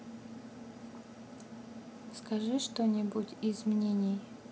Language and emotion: Russian, neutral